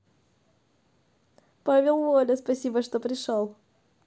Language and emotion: Russian, positive